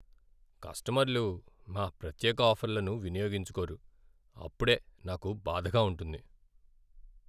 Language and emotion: Telugu, sad